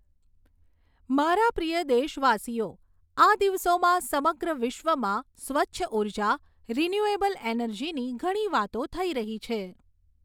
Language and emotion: Gujarati, neutral